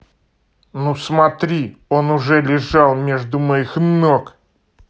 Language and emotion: Russian, angry